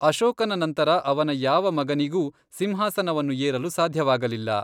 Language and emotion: Kannada, neutral